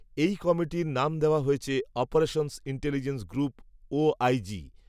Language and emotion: Bengali, neutral